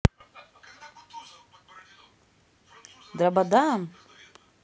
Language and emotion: Russian, neutral